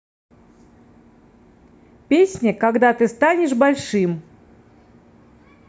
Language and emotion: Russian, neutral